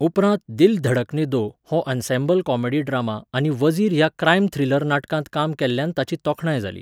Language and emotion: Goan Konkani, neutral